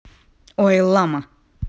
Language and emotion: Russian, angry